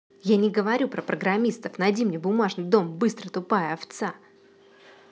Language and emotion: Russian, angry